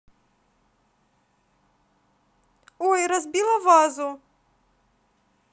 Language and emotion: Russian, positive